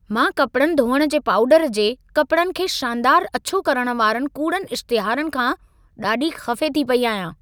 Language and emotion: Sindhi, angry